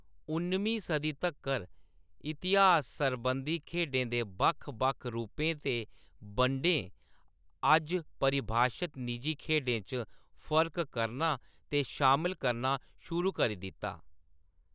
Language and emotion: Dogri, neutral